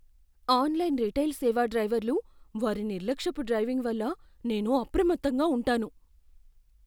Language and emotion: Telugu, fearful